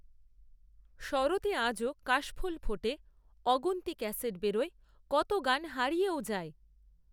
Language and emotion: Bengali, neutral